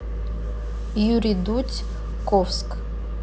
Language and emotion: Russian, neutral